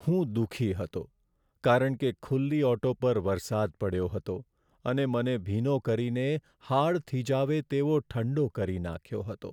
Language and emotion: Gujarati, sad